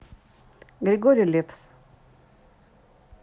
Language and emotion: Russian, neutral